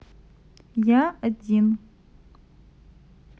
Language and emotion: Russian, neutral